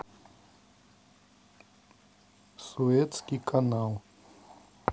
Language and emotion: Russian, neutral